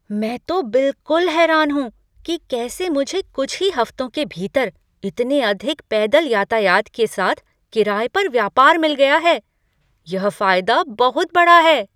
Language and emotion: Hindi, surprised